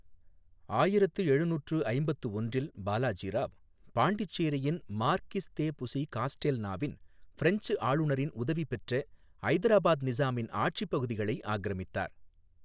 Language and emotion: Tamil, neutral